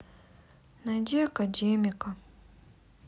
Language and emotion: Russian, sad